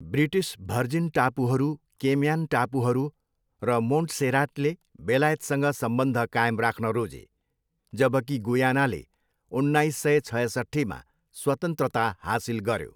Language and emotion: Nepali, neutral